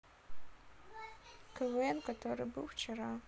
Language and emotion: Russian, sad